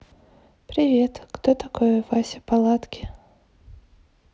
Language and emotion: Russian, neutral